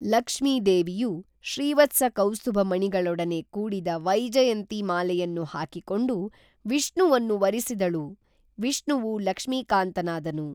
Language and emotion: Kannada, neutral